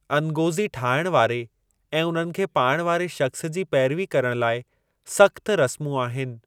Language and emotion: Sindhi, neutral